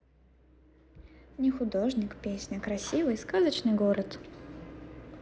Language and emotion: Russian, positive